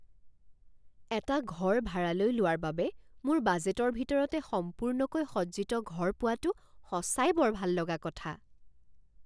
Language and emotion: Assamese, surprised